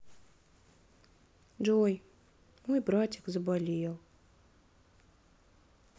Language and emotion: Russian, sad